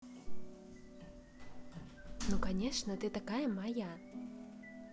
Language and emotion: Russian, positive